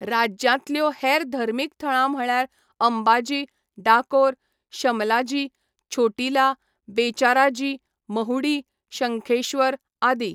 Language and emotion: Goan Konkani, neutral